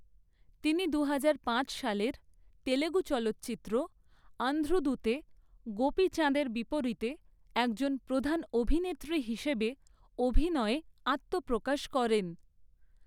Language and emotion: Bengali, neutral